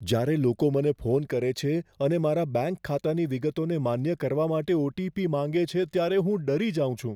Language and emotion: Gujarati, fearful